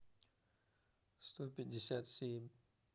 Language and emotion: Russian, neutral